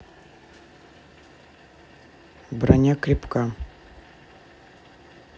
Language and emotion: Russian, neutral